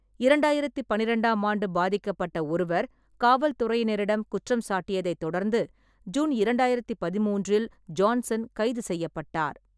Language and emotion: Tamil, neutral